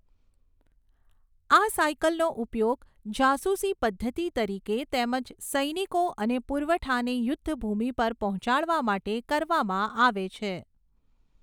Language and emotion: Gujarati, neutral